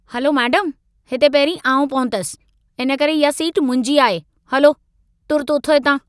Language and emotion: Sindhi, angry